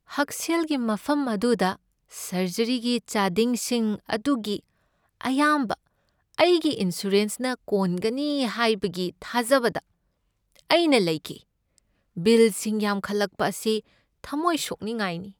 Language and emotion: Manipuri, sad